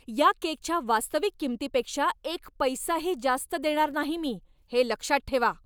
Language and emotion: Marathi, angry